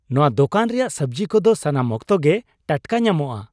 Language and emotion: Santali, happy